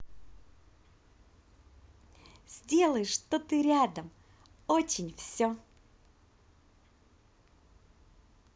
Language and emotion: Russian, positive